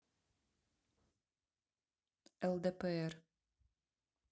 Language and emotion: Russian, neutral